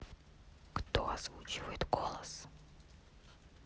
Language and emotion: Russian, neutral